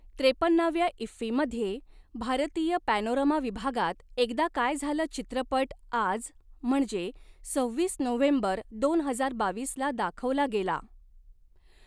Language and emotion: Marathi, neutral